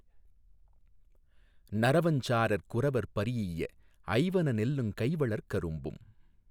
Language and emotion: Tamil, neutral